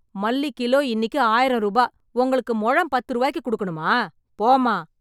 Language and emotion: Tamil, angry